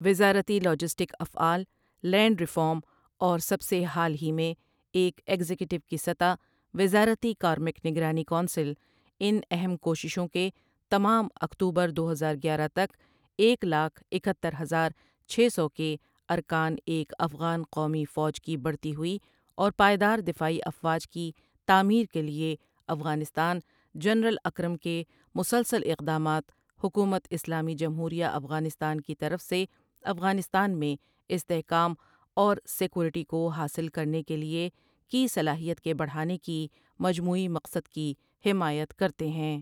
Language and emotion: Urdu, neutral